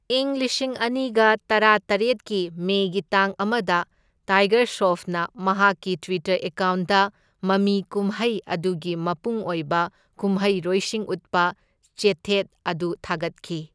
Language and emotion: Manipuri, neutral